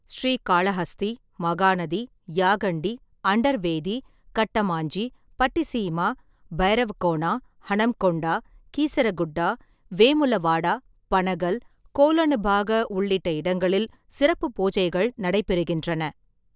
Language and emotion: Tamil, neutral